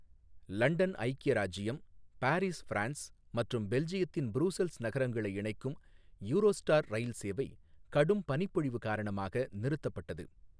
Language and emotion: Tamil, neutral